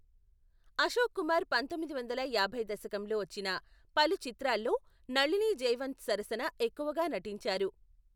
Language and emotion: Telugu, neutral